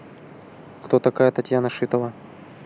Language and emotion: Russian, neutral